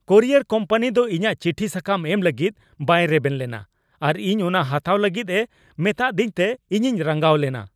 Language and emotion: Santali, angry